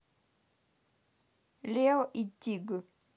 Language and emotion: Russian, neutral